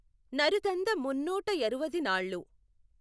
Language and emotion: Telugu, neutral